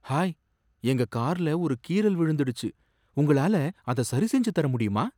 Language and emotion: Tamil, surprised